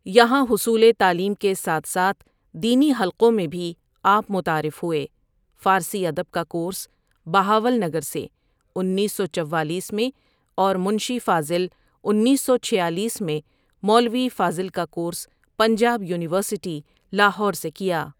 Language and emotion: Urdu, neutral